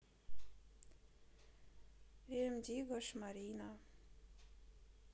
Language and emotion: Russian, neutral